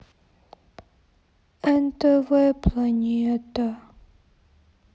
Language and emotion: Russian, sad